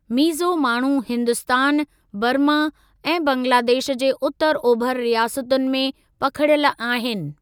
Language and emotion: Sindhi, neutral